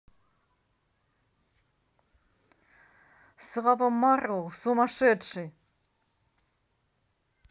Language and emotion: Russian, angry